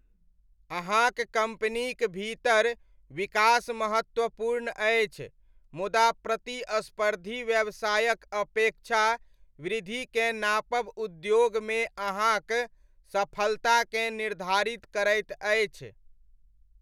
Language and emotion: Maithili, neutral